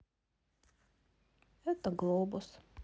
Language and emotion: Russian, sad